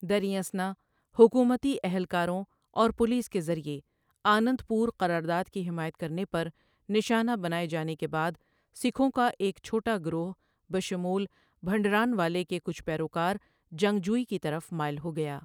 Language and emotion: Urdu, neutral